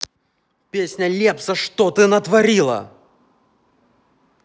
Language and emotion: Russian, angry